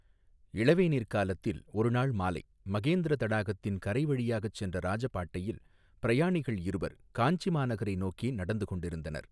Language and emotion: Tamil, neutral